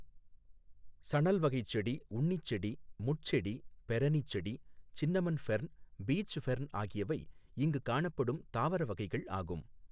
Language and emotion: Tamil, neutral